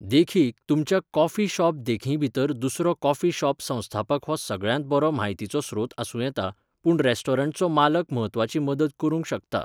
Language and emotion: Goan Konkani, neutral